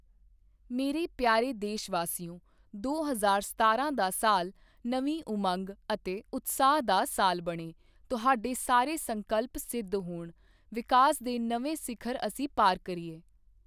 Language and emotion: Punjabi, neutral